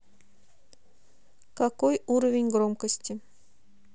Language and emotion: Russian, neutral